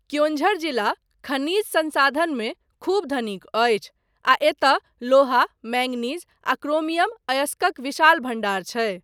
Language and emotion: Maithili, neutral